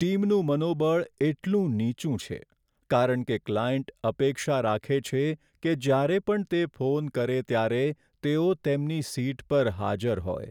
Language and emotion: Gujarati, sad